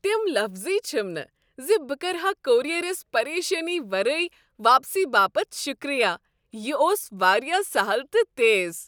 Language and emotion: Kashmiri, happy